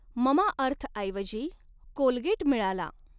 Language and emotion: Marathi, neutral